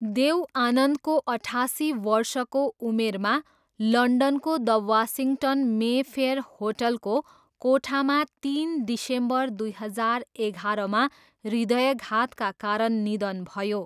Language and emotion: Nepali, neutral